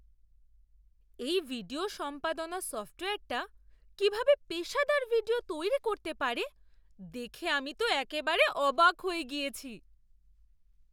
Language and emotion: Bengali, surprised